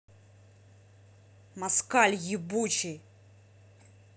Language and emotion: Russian, angry